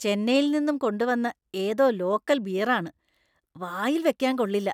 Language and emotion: Malayalam, disgusted